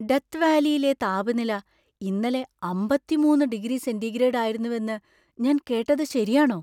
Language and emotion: Malayalam, surprised